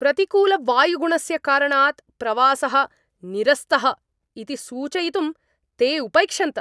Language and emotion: Sanskrit, angry